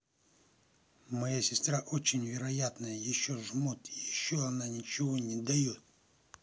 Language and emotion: Russian, angry